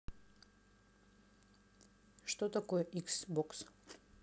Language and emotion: Russian, neutral